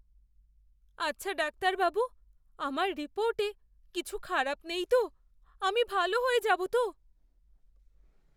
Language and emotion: Bengali, fearful